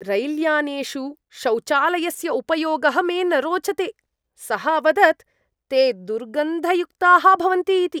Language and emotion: Sanskrit, disgusted